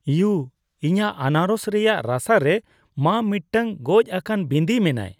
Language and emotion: Santali, disgusted